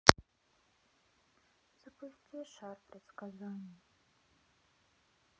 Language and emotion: Russian, sad